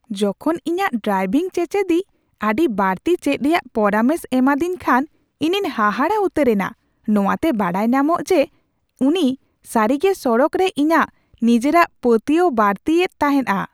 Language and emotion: Santali, surprised